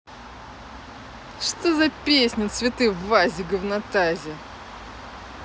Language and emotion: Russian, positive